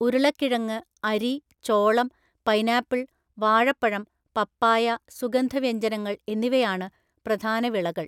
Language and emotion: Malayalam, neutral